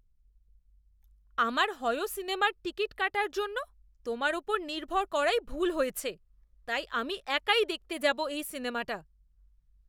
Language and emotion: Bengali, disgusted